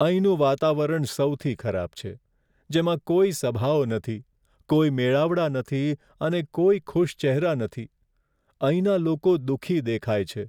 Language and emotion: Gujarati, sad